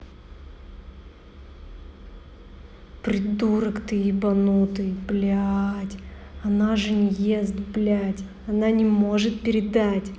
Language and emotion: Russian, angry